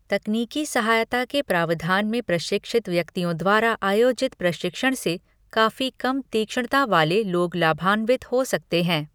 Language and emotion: Hindi, neutral